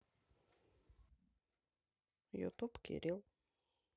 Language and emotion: Russian, neutral